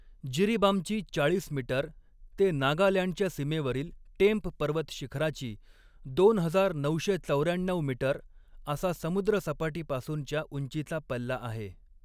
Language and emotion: Marathi, neutral